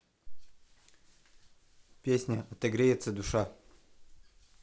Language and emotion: Russian, neutral